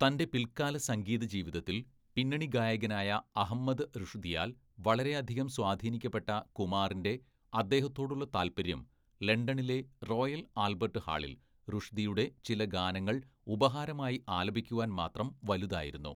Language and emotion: Malayalam, neutral